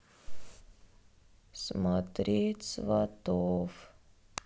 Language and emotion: Russian, sad